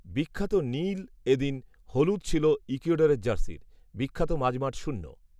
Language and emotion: Bengali, neutral